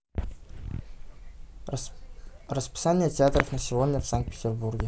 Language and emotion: Russian, neutral